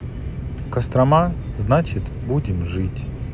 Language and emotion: Russian, sad